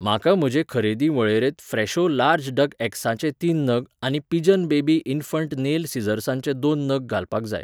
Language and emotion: Goan Konkani, neutral